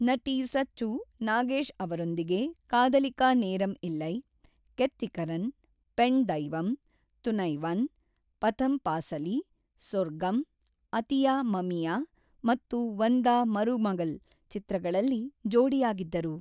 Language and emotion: Kannada, neutral